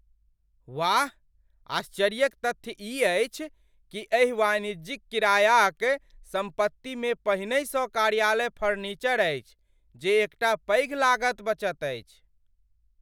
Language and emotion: Maithili, surprised